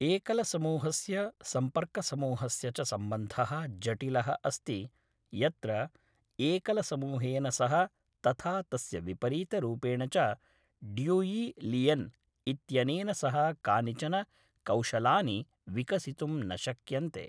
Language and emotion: Sanskrit, neutral